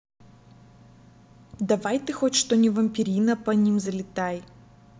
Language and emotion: Russian, angry